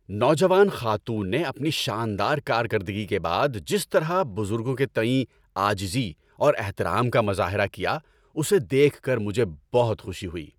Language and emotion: Urdu, happy